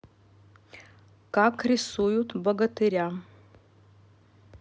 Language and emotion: Russian, neutral